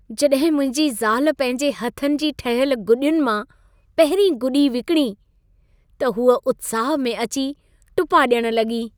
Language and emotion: Sindhi, happy